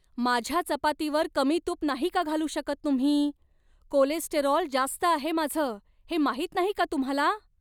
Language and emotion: Marathi, angry